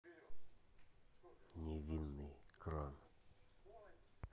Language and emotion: Russian, neutral